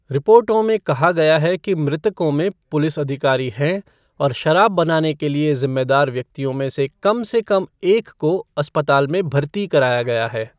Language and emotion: Hindi, neutral